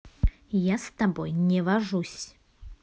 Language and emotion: Russian, angry